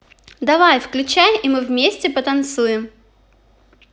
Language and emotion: Russian, positive